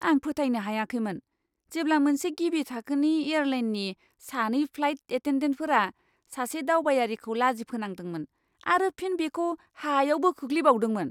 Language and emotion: Bodo, disgusted